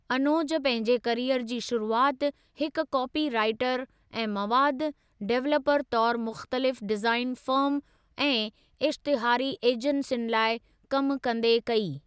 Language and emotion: Sindhi, neutral